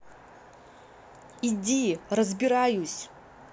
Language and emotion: Russian, angry